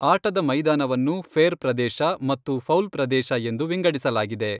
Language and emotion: Kannada, neutral